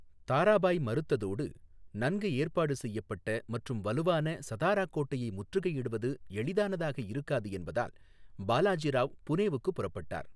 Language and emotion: Tamil, neutral